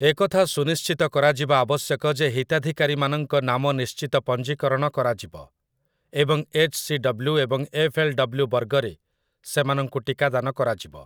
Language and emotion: Odia, neutral